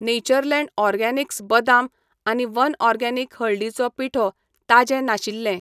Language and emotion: Goan Konkani, neutral